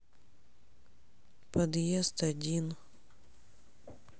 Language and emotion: Russian, sad